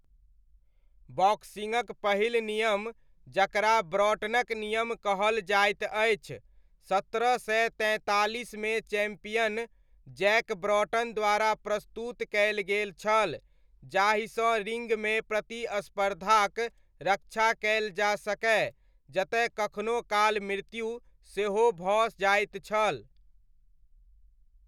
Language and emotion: Maithili, neutral